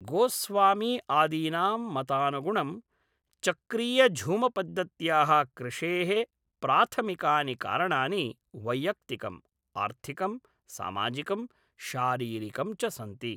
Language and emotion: Sanskrit, neutral